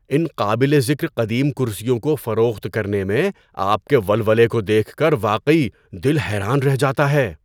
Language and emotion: Urdu, surprised